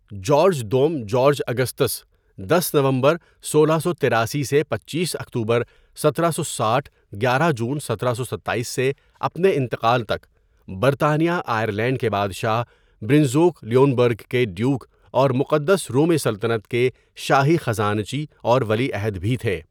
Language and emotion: Urdu, neutral